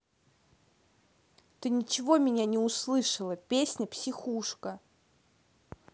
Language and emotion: Russian, angry